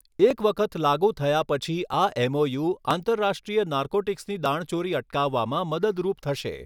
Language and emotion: Gujarati, neutral